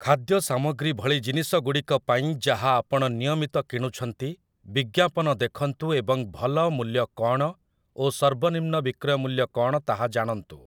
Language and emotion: Odia, neutral